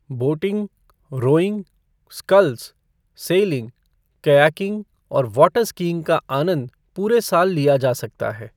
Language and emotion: Hindi, neutral